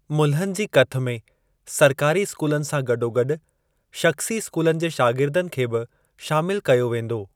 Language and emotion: Sindhi, neutral